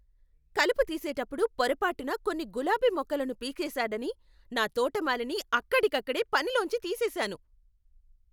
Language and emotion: Telugu, angry